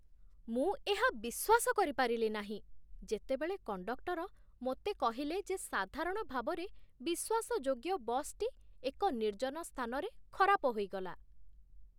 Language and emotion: Odia, surprised